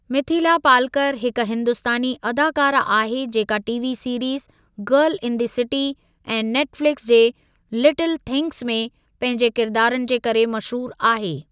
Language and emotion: Sindhi, neutral